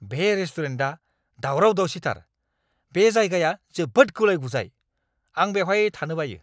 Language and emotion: Bodo, angry